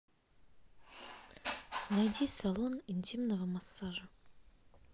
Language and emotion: Russian, neutral